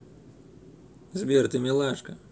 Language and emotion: Russian, positive